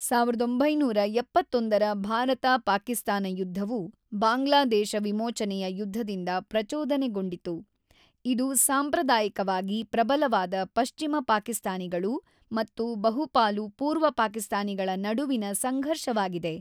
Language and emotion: Kannada, neutral